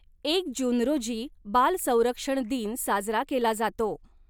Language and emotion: Marathi, neutral